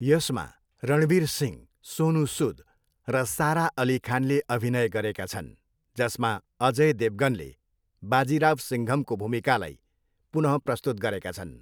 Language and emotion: Nepali, neutral